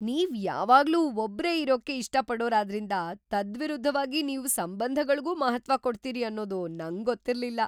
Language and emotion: Kannada, surprised